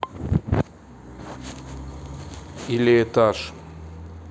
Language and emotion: Russian, neutral